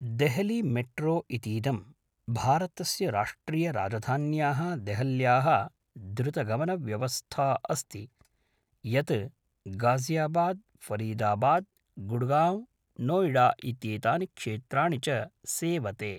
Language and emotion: Sanskrit, neutral